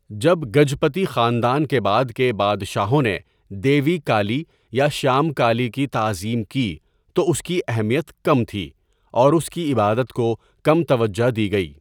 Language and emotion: Urdu, neutral